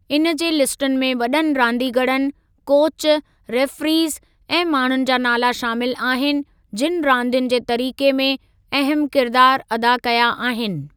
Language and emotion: Sindhi, neutral